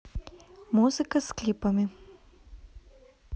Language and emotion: Russian, neutral